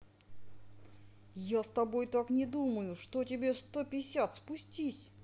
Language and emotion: Russian, angry